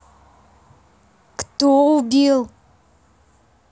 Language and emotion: Russian, angry